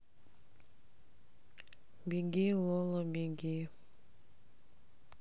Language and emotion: Russian, sad